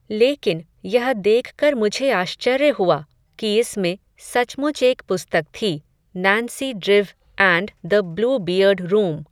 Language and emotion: Hindi, neutral